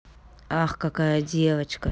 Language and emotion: Russian, neutral